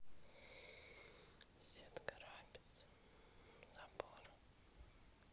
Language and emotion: Russian, neutral